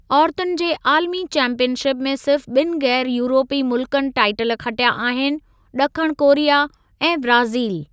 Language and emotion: Sindhi, neutral